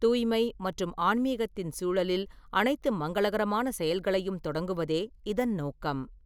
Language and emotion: Tamil, neutral